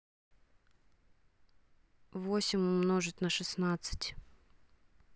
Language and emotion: Russian, neutral